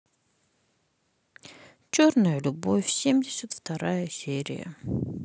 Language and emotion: Russian, sad